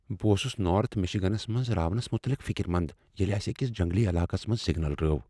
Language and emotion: Kashmiri, fearful